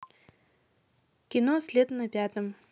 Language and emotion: Russian, neutral